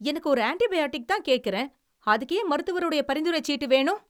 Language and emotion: Tamil, angry